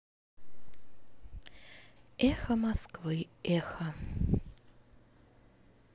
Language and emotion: Russian, sad